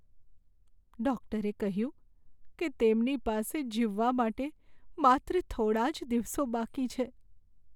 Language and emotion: Gujarati, sad